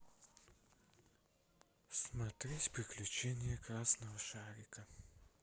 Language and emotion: Russian, sad